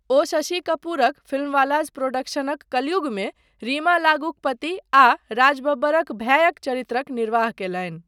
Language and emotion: Maithili, neutral